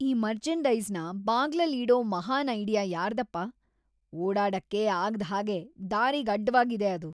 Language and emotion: Kannada, disgusted